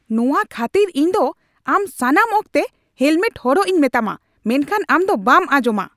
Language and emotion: Santali, angry